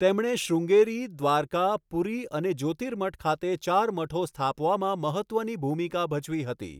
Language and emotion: Gujarati, neutral